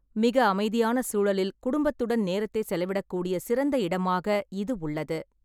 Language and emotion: Tamil, neutral